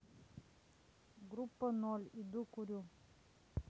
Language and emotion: Russian, neutral